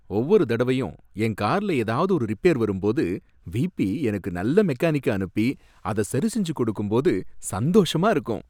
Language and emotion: Tamil, happy